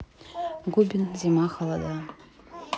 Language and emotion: Russian, neutral